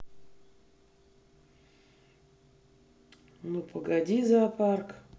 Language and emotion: Russian, neutral